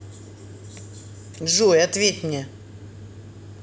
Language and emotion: Russian, neutral